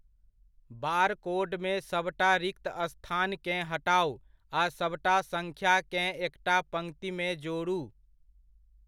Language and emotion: Maithili, neutral